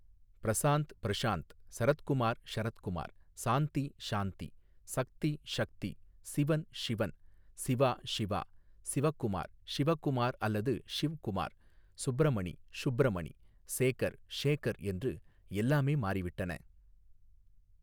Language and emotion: Tamil, neutral